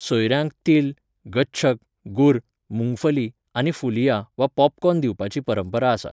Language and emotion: Goan Konkani, neutral